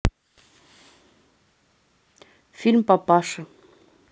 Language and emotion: Russian, neutral